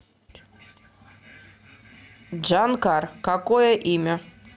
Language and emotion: Russian, neutral